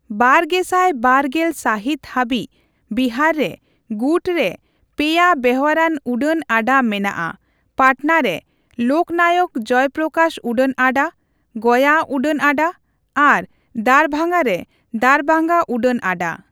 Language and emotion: Santali, neutral